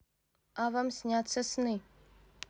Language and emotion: Russian, neutral